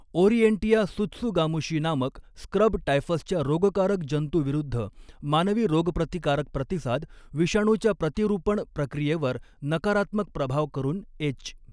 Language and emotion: Marathi, neutral